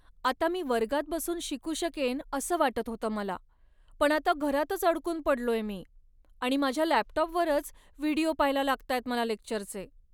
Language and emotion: Marathi, sad